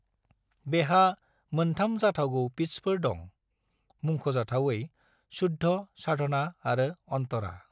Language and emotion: Bodo, neutral